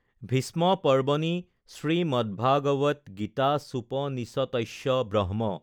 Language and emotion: Assamese, neutral